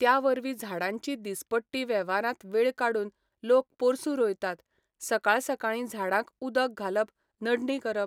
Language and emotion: Goan Konkani, neutral